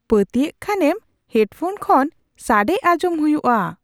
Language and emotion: Santali, surprised